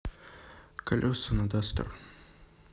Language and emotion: Russian, neutral